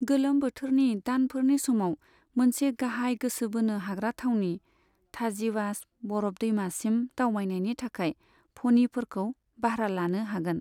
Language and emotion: Bodo, neutral